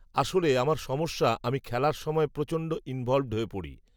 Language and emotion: Bengali, neutral